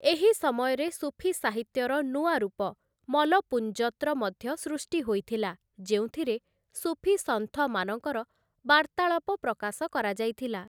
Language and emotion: Odia, neutral